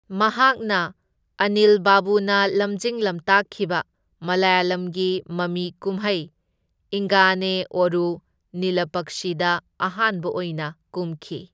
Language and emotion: Manipuri, neutral